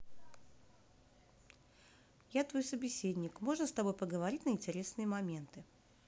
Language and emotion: Russian, neutral